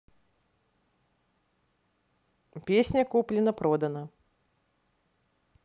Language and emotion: Russian, neutral